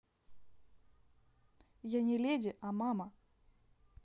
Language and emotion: Russian, neutral